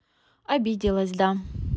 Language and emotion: Russian, neutral